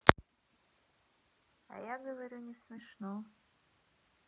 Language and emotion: Russian, neutral